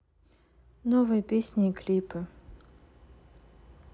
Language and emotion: Russian, neutral